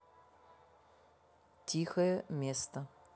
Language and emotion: Russian, neutral